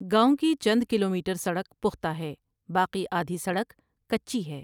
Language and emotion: Urdu, neutral